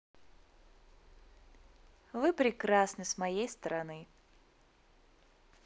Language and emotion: Russian, positive